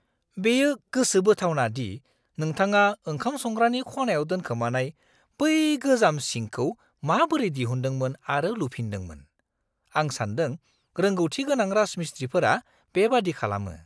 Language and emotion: Bodo, surprised